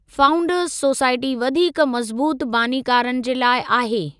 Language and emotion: Sindhi, neutral